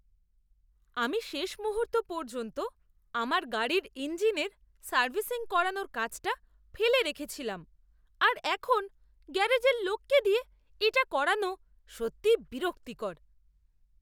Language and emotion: Bengali, disgusted